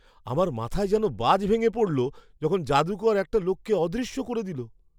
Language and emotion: Bengali, surprised